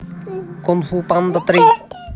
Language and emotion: Russian, neutral